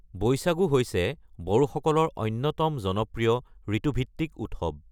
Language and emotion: Assamese, neutral